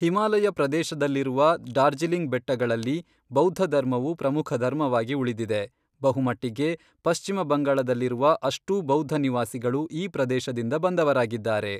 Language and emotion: Kannada, neutral